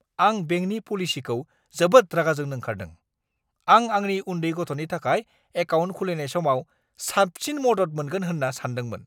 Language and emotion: Bodo, angry